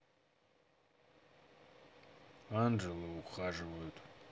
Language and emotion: Russian, neutral